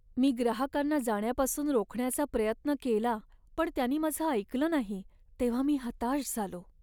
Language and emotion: Marathi, sad